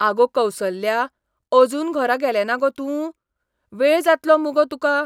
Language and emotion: Goan Konkani, surprised